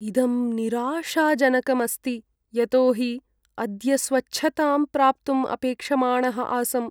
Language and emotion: Sanskrit, sad